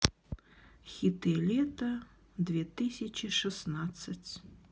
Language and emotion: Russian, sad